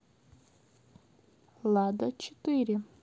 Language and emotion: Russian, neutral